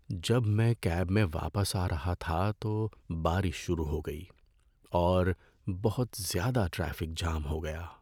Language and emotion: Urdu, sad